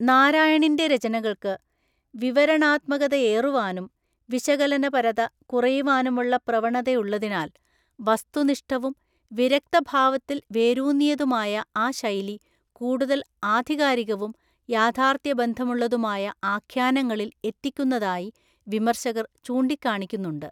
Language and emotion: Malayalam, neutral